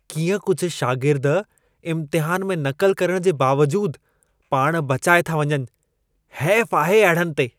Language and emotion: Sindhi, disgusted